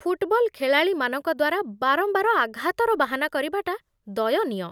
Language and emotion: Odia, disgusted